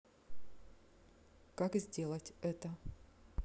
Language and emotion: Russian, neutral